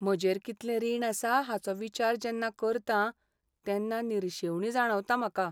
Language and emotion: Goan Konkani, sad